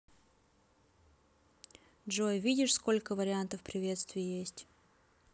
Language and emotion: Russian, neutral